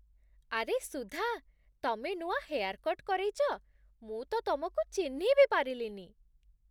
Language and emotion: Odia, surprised